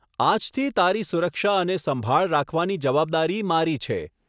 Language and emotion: Gujarati, neutral